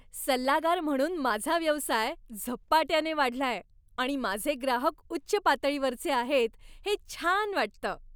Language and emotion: Marathi, happy